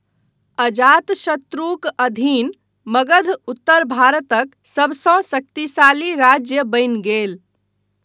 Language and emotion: Maithili, neutral